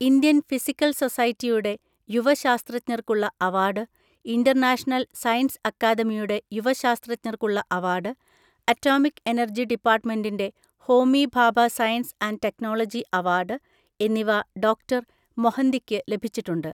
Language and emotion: Malayalam, neutral